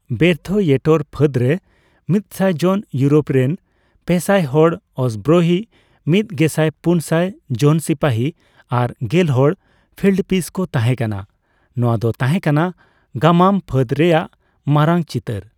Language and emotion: Santali, neutral